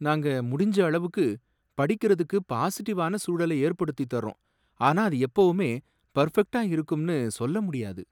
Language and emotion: Tamil, sad